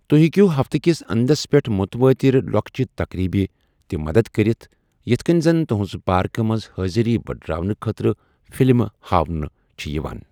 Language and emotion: Kashmiri, neutral